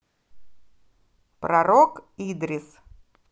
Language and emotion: Russian, positive